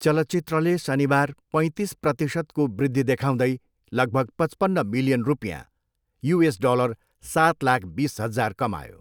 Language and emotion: Nepali, neutral